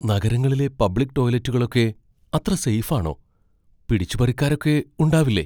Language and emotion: Malayalam, fearful